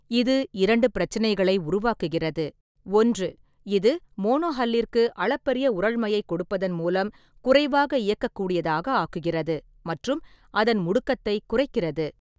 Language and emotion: Tamil, neutral